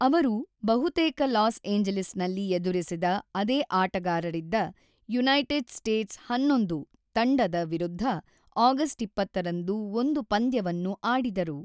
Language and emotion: Kannada, neutral